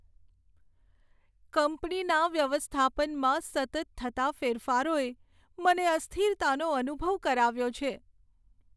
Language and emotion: Gujarati, sad